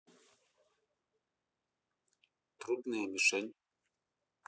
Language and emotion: Russian, neutral